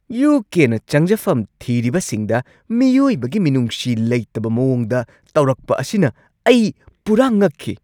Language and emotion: Manipuri, angry